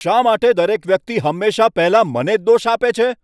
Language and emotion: Gujarati, angry